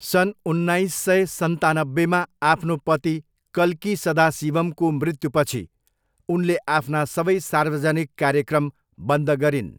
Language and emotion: Nepali, neutral